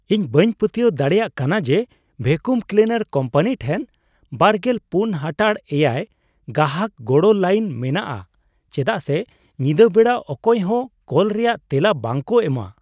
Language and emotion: Santali, surprised